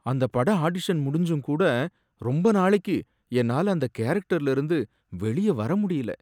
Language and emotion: Tamil, sad